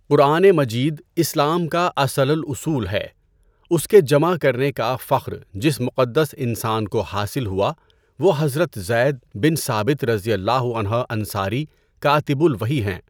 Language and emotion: Urdu, neutral